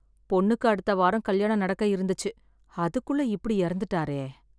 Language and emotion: Tamil, sad